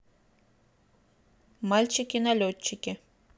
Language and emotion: Russian, neutral